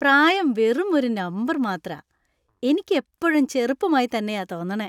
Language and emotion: Malayalam, happy